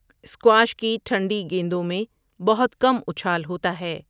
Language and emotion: Urdu, neutral